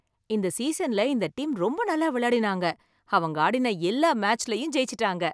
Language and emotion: Tamil, happy